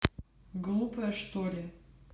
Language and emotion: Russian, neutral